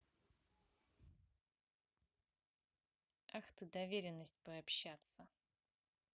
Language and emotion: Russian, neutral